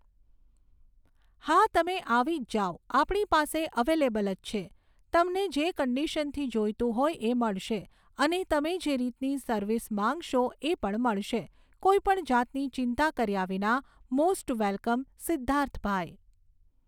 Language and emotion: Gujarati, neutral